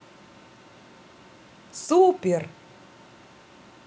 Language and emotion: Russian, positive